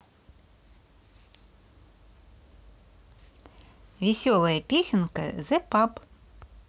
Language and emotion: Russian, positive